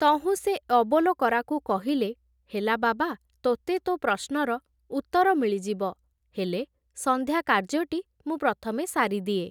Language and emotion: Odia, neutral